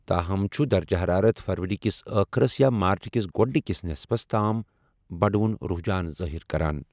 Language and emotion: Kashmiri, neutral